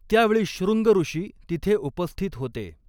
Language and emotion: Marathi, neutral